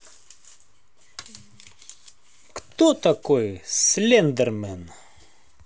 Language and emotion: Russian, positive